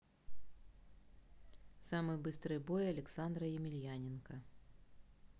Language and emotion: Russian, neutral